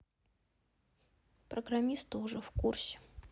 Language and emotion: Russian, sad